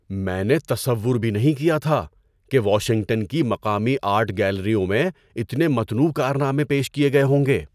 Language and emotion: Urdu, surprised